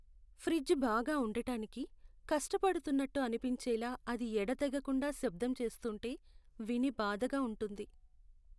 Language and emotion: Telugu, sad